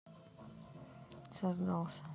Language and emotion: Russian, neutral